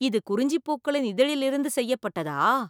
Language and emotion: Tamil, surprised